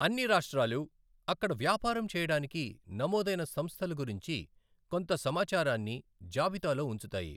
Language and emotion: Telugu, neutral